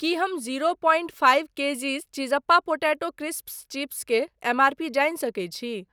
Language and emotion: Maithili, neutral